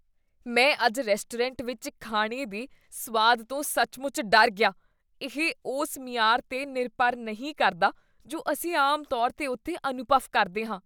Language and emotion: Punjabi, disgusted